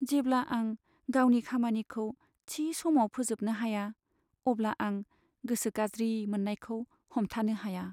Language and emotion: Bodo, sad